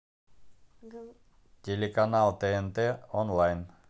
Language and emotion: Russian, neutral